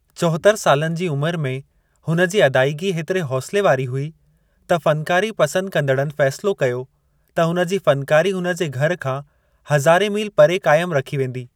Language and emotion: Sindhi, neutral